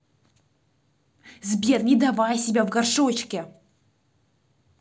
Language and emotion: Russian, angry